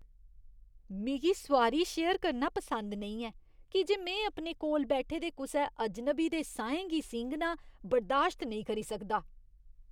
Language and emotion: Dogri, disgusted